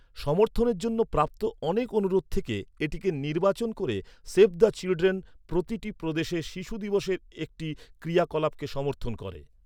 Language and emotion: Bengali, neutral